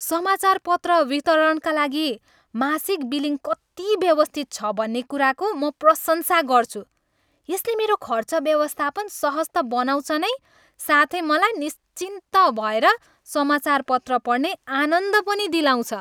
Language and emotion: Nepali, happy